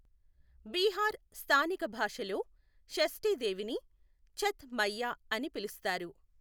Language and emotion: Telugu, neutral